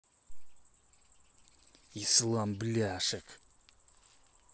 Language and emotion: Russian, angry